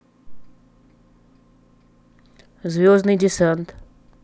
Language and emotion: Russian, neutral